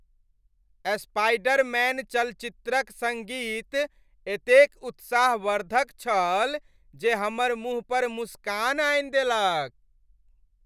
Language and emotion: Maithili, happy